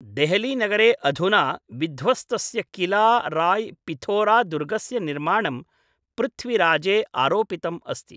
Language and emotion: Sanskrit, neutral